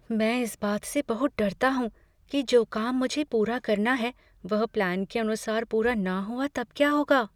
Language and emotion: Hindi, fearful